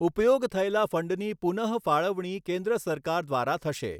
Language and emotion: Gujarati, neutral